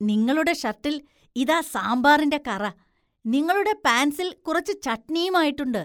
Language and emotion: Malayalam, disgusted